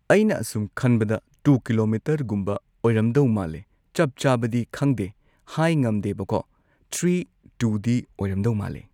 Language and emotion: Manipuri, neutral